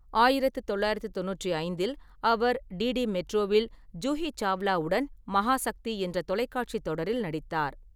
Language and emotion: Tamil, neutral